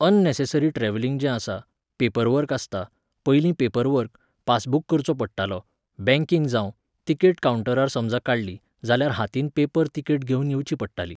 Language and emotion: Goan Konkani, neutral